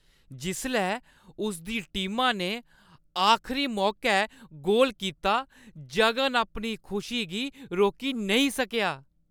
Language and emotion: Dogri, happy